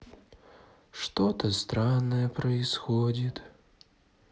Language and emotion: Russian, sad